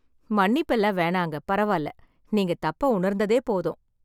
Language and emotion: Tamil, happy